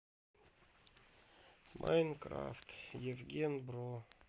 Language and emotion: Russian, sad